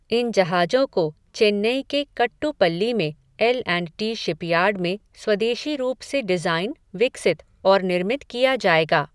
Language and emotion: Hindi, neutral